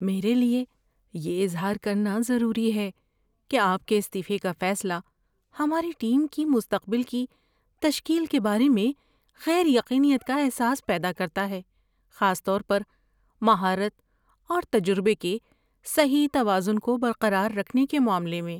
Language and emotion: Urdu, fearful